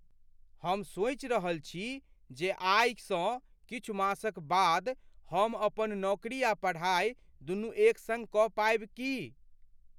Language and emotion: Maithili, fearful